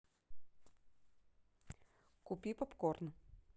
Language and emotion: Russian, neutral